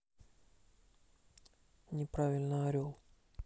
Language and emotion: Russian, neutral